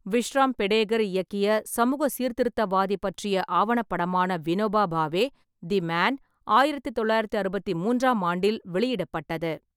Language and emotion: Tamil, neutral